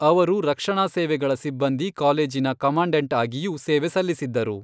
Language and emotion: Kannada, neutral